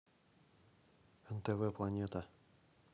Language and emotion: Russian, neutral